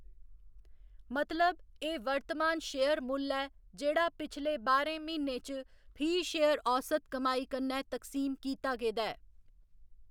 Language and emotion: Dogri, neutral